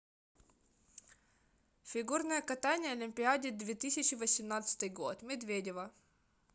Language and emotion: Russian, neutral